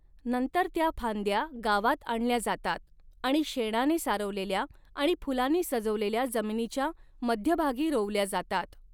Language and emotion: Marathi, neutral